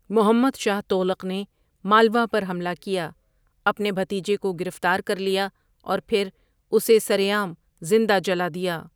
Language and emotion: Urdu, neutral